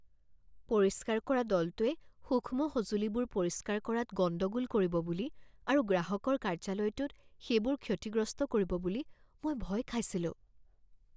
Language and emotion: Assamese, fearful